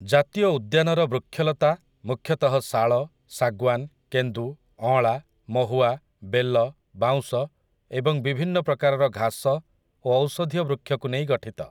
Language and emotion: Odia, neutral